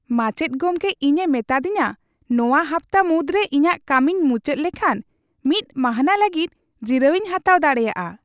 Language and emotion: Santali, happy